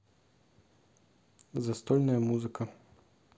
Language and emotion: Russian, neutral